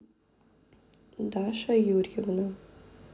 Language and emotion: Russian, neutral